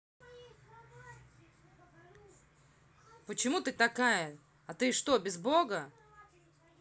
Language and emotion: Russian, angry